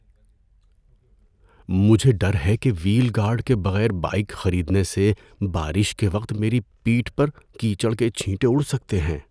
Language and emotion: Urdu, fearful